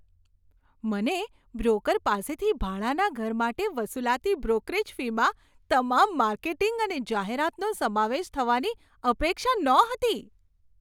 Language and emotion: Gujarati, surprised